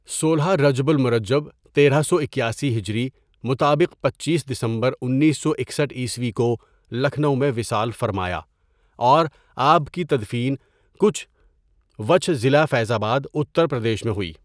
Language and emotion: Urdu, neutral